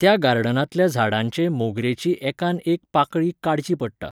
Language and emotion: Goan Konkani, neutral